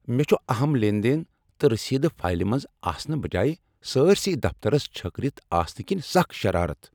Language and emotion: Kashmiri, angry